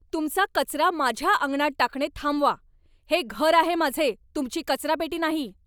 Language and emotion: Marathi, angry